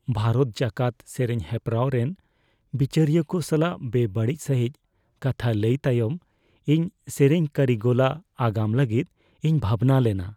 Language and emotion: Santali, fearful